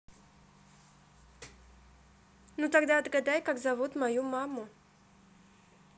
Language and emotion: Russian, neutral